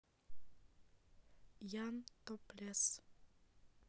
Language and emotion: Russian, neutral